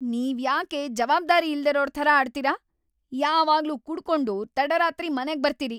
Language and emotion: Kannada, angry